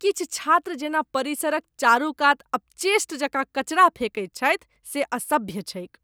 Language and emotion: Maithili, disgusted